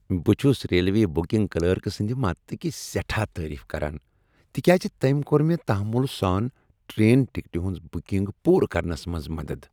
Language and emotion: Kashmiri, happy